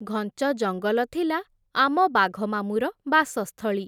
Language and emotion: Odia, neutral